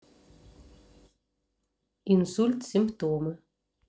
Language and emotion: Russian, neutral